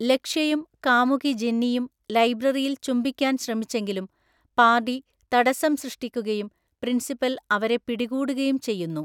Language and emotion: Malayalam, neutral